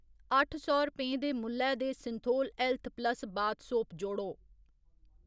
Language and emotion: Dogri, neutral